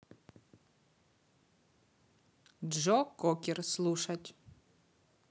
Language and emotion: Russian, neutral